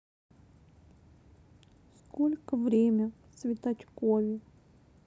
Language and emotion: Russian, sad